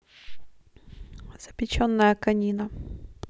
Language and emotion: Russian, neutral